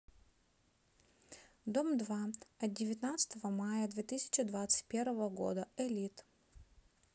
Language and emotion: Russian, neutral